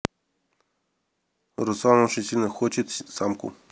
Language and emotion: Russian, neutral